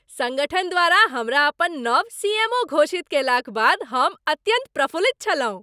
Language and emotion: Maithili, happy